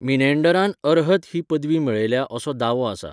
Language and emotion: Goan Konkani, neutral